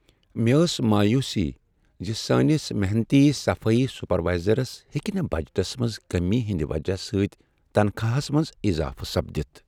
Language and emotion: Kashmiri, sad